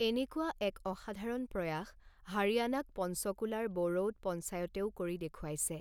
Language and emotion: Assamese, neutral